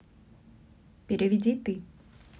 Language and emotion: Russian, neutral